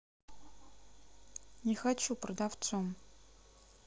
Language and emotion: Russian, sad